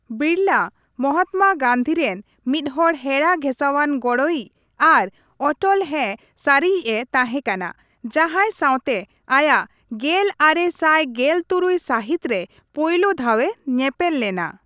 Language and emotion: Santali, neutral